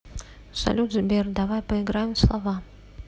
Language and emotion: Russian, neutral